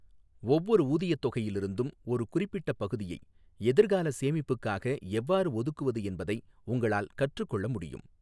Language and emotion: Tamil, neutral